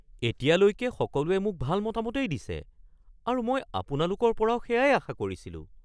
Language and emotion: Assamese, surprised